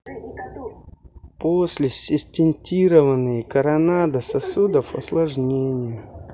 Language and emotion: Russian, neutral